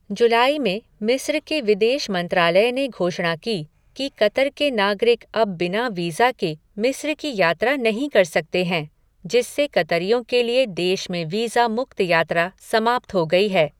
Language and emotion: Hindi, neutral